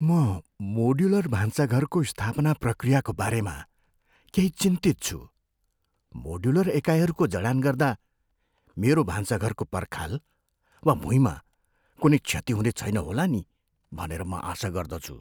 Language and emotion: Nepali, fearful